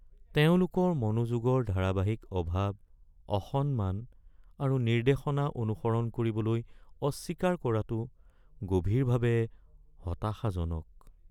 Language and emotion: Assamese, sad